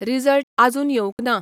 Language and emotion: Goan Konkani, neutral